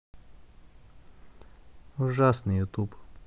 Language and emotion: Russian, sad